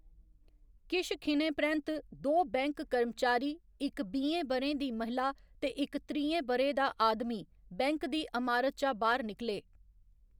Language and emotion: Dogri, neutral